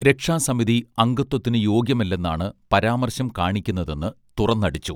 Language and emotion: Malayalam, neutral